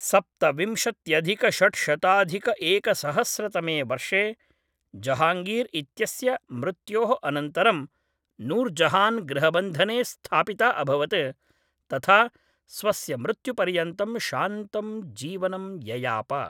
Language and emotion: Sanskrit, neutral